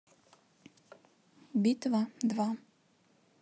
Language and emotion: Russian, neutral